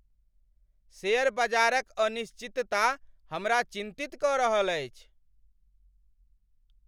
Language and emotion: Maithili, angry